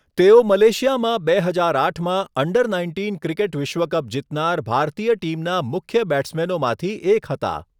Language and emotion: Gujarati, neutral